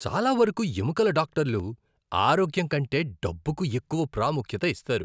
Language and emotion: Telugu, disgusted